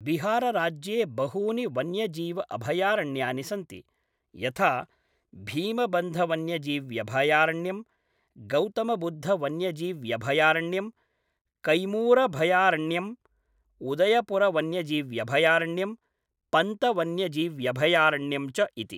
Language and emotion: Sanskrit, neutral